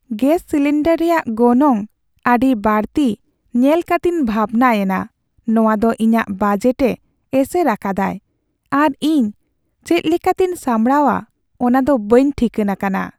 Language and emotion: Santali, sad